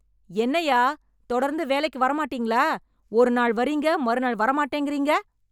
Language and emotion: Tamil, angry